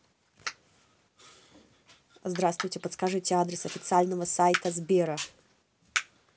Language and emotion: Russian, neutral